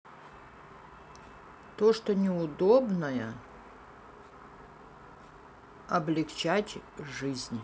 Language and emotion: Russian, neutral